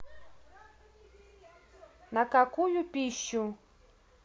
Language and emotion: Russian, neutral